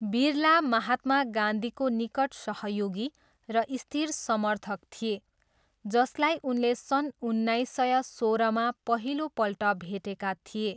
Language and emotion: Nepali, neutral